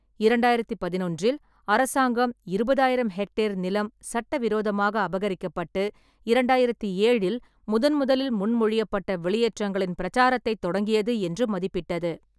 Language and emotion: Tamil, neutral